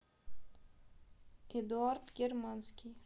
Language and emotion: Russian, neutral